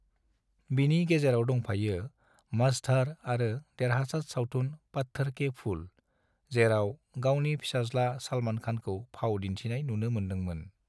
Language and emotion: Bodo, neutral